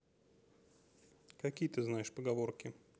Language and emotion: Russian, neutral